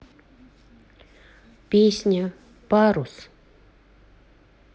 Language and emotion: Russian, neutral